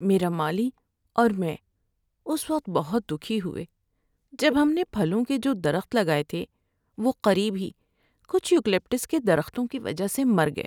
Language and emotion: Urdu, sad